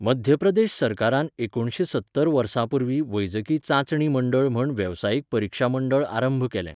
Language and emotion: Goan Konkani, neutral